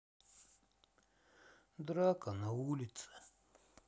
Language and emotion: Russian, sad